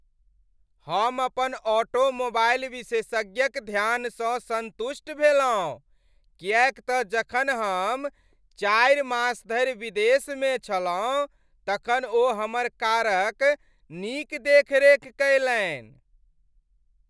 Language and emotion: Maithili, happy